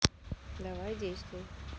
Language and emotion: Russian, neutral